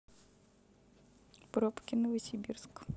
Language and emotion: Russian, neutral